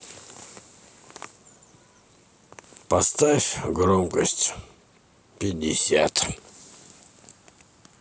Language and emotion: Russian, neutral